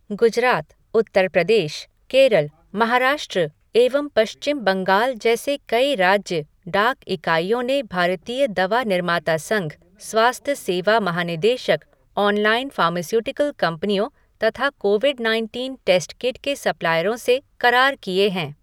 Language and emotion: Hindi, neutral